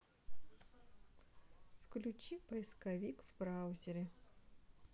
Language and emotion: Russian, neutral